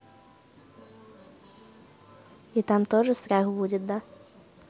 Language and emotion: Russian, neutral